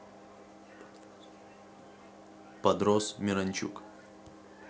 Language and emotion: Russian, neutral